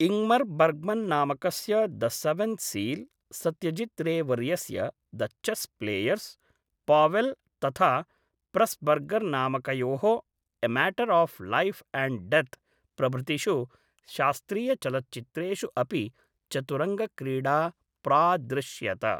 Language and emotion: Sanskrit, neutral